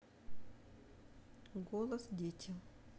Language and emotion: Russian, neutral